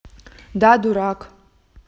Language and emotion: Russian, angry